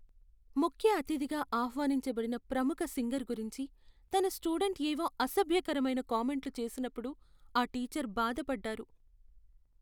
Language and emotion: Telugu, sad